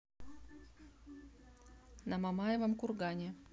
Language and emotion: Russian, neutral